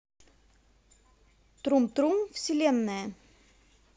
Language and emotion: Russian, positive